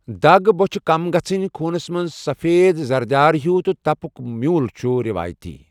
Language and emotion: Kashmiri, neutral